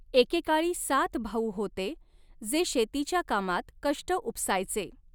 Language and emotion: Marathi, neutral